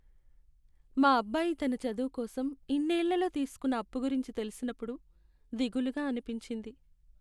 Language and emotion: Telugu, sad